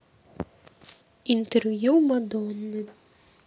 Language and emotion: Russian, neutral